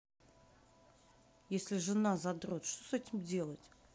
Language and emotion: Russian, neutral